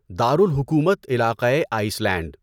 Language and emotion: Urdu, neutral